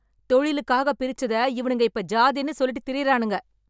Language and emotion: Tamil, angry